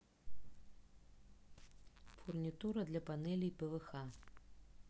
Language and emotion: Russian, neutral